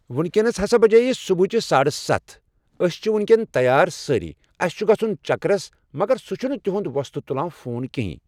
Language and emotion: Kashmiri, neutral